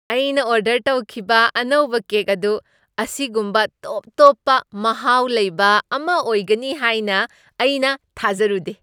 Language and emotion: Manipuri, surprised